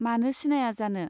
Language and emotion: Bodo, neutral